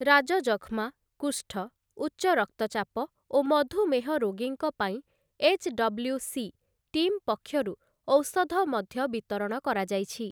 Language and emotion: Odia, neutral